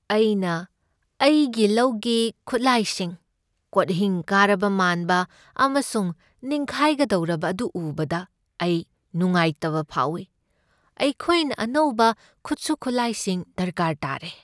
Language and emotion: Manipuri, sad